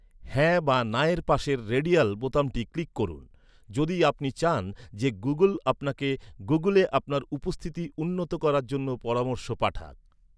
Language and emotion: Bengali, neutral